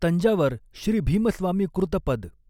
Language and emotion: Marathi, neutral